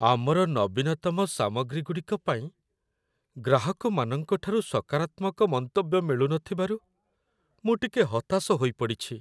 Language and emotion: Odia, sad